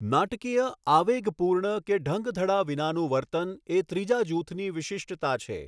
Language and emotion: Gujarati, neutral